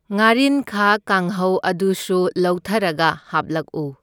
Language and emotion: Manipuri, neutral